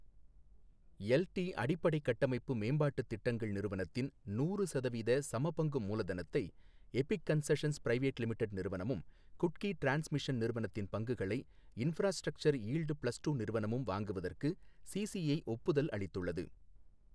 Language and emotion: Tamil, neutral